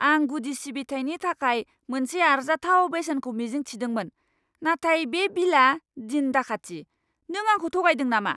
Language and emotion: Bodo, angry